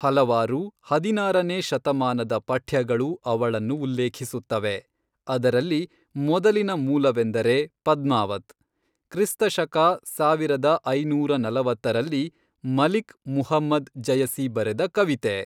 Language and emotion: Kannada, neutral